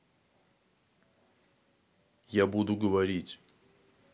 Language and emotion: Russian, neutral